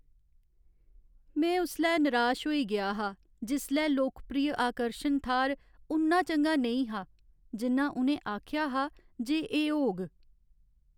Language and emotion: Dogri, sad